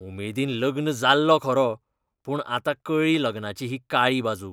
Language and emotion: Goan Konkani, disgusted